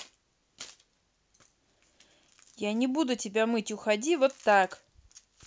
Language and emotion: Russian, angry